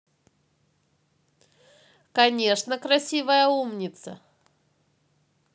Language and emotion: Russian, positive